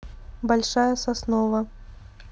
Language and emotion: Russian, neutral